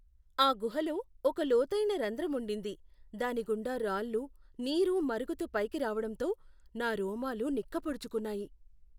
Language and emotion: Telugu, fearful